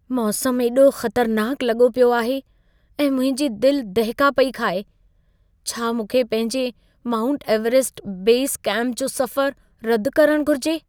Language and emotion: Sindhi, fearful